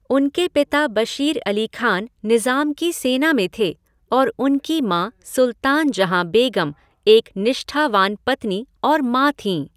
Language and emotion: Hindi, neutral